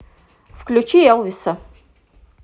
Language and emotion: Russian, neutral